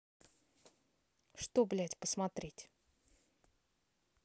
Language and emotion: Russian, angry